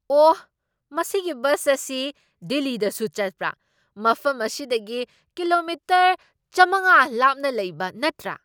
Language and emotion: Manipuri, surprised